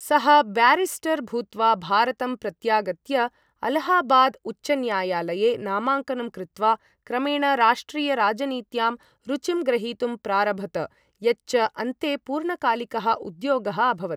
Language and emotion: Sanskrit, neutral